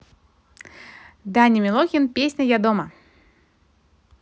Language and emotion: Russian, positive